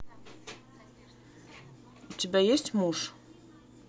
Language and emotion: Russian, neutral